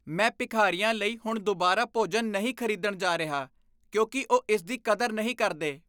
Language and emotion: Punjabi, disgusted